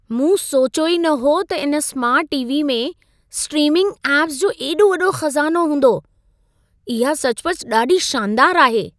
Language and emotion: Sindhi, surprised